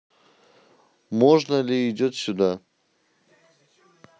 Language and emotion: Russian, neutral